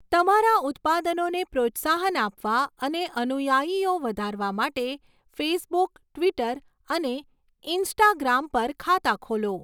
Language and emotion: Gujarati, neutral